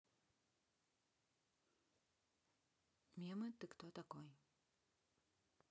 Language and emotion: Russian, neutral